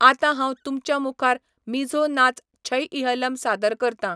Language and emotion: Goan Konkani, neutral